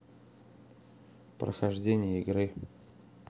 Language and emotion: Russian, neutral